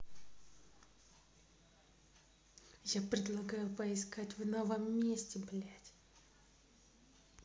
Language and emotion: Russian, angry